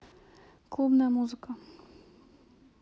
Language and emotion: Russian, neutral